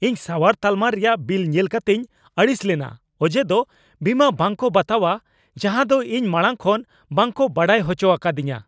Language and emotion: Santali, angry